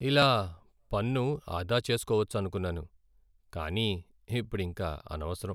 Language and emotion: Telugu, sad